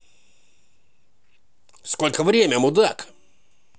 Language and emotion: Russian, positive